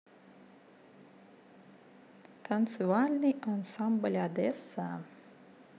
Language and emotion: Russian, positive